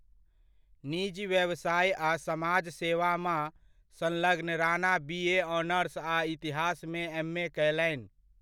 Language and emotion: Maithili, neutral